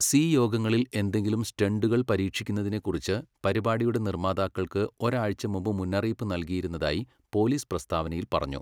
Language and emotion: Malayalam, neutral